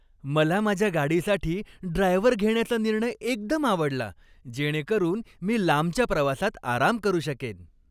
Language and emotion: Marathi, happy